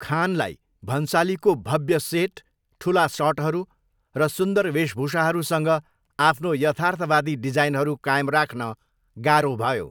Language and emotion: Nepali, neutral